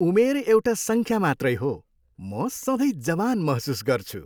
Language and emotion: Nepali, happy